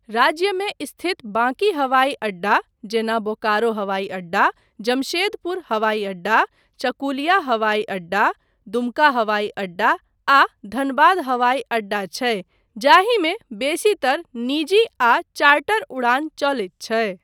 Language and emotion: Maithili, neutral